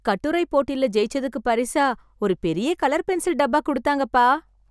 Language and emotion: Tamil, happy